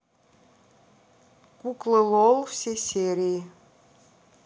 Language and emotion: Russian, neutral